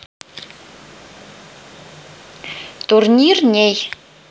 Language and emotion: Russian, neutral